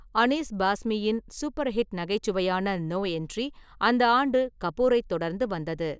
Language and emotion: Tamil, neutral